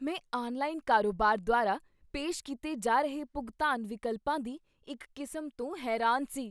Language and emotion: Punjabi, surprised